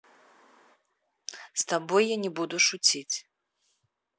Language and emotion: Russian, neutral